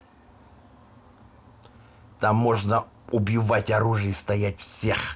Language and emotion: Russian, angry